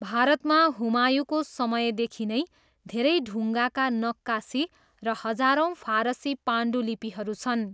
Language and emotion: Nepali, neutral